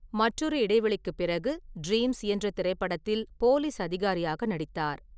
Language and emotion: Tamil, neutral